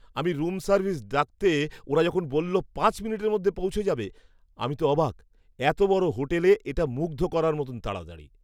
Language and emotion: Bengali, surprised